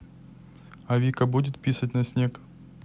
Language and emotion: Russian, neutral